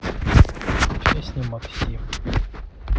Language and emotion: Russian, neutral